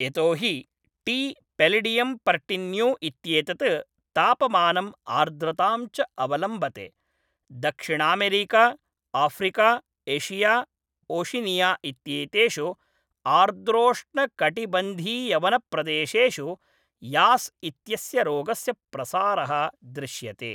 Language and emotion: Sanskrit, neutral